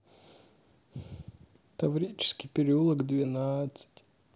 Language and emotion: Russian, sad